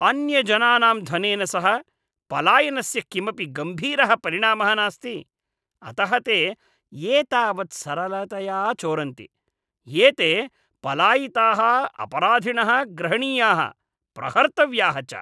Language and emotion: Sanskrit, disgusted